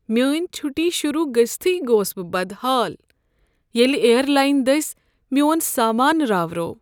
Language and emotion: Kashmiri, sad